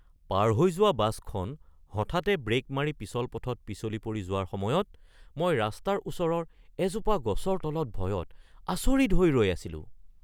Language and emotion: Assamese, surprised